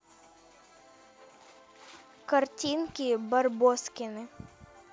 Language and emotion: Russian, neutral